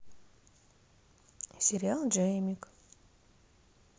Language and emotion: Russian, neutral